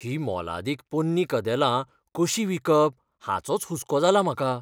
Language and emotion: Goan Konkani, fearful